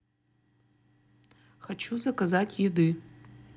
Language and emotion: Russian, neutral